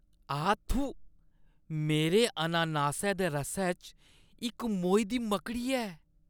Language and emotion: Dogri, disgusted